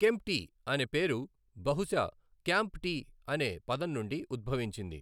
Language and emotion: Telugu, neutral